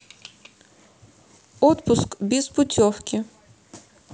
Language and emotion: Russian, neutral